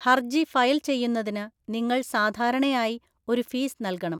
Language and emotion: Malayalam, neutral